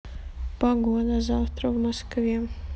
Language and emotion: Russian, sad